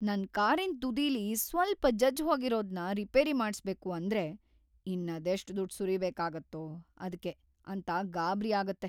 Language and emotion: Kannada, fearful